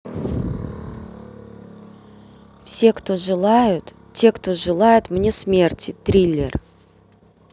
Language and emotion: Russian, neutral